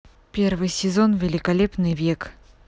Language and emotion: Russian, neutral